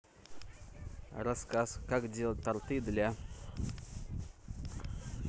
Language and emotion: Russian, neutral